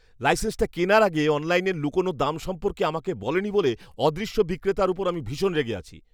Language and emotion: Bengali, angry